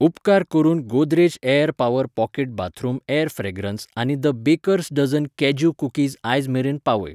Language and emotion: Goan Konkani, neutral